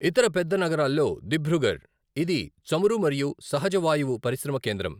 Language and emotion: Telugu, neutral